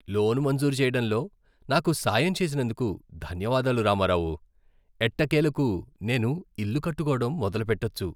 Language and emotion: Telugu, happy